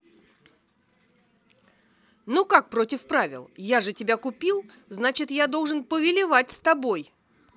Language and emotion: Russian, angry